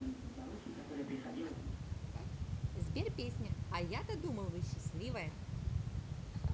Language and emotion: Russian, positive